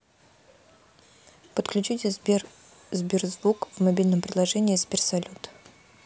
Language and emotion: Russian, neutral